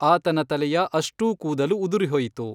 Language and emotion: Kannada, neutral